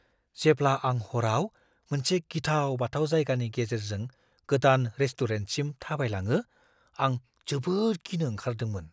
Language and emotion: Bodo, fearful